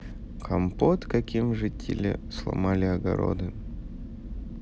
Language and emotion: Russian, neutral